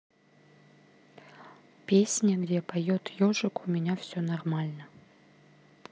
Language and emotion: Russian, neutral